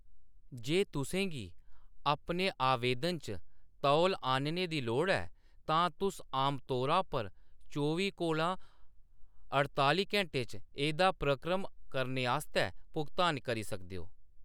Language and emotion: Dogri, neutral